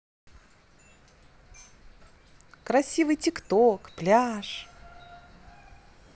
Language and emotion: Russian, positive